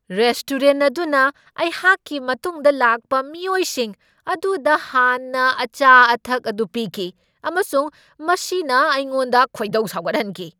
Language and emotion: Manipuri, angry